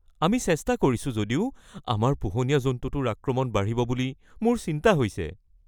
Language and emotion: Assamese, fearful